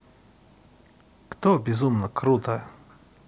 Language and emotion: Russian, neutral